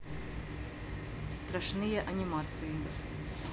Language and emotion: Russian, neutral